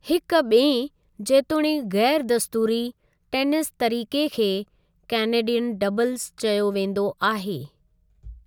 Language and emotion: Sindhi, neutral